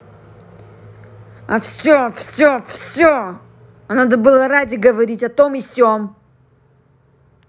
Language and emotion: Russian, angry